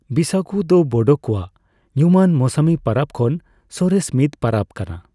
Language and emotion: Santali, neutral